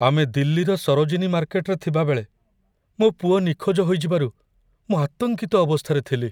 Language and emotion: Odia, fearful